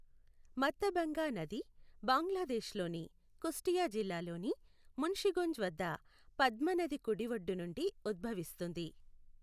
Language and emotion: Telugu, neutral